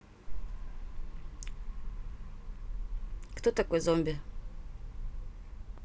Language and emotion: Russian, neutral